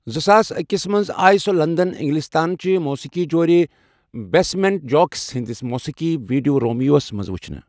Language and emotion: Kashmiri, neutral